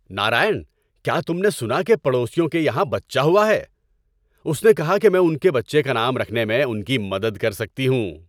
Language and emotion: Urdu, happy